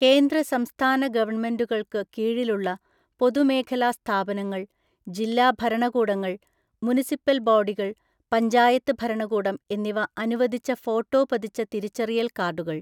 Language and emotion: Malayalam, neutral